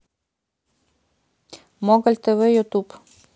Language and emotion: Russian, neutral